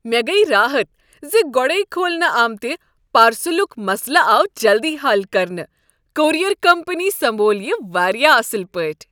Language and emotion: Kashmiri, happy